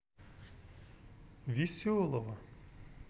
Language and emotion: Russian, neutral